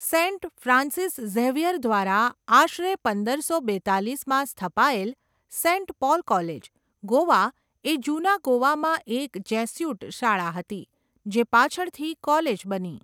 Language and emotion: Gujarati, neutral